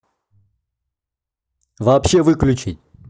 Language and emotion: Russian, angry